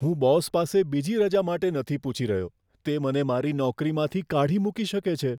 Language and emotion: Gujarati, fearful